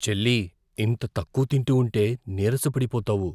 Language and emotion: Telugu, fearful